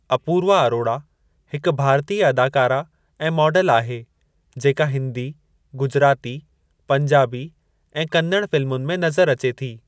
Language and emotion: Sindhi, neutral